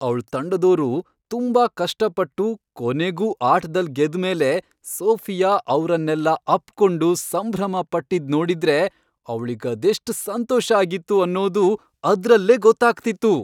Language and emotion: Kannada, happy